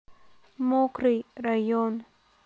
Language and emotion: Russian, neutral